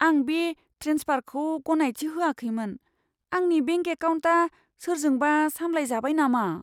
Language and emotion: Bodo, fearful